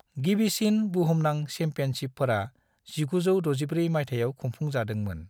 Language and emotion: Bodo, neutral